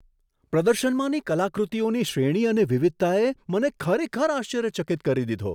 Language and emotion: Gujarati, surprised